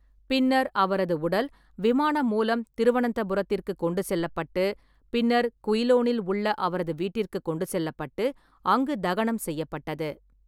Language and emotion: Tamil, neutral